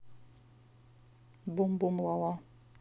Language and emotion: Russian, neutral